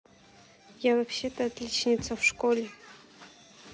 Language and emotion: Russian, neutral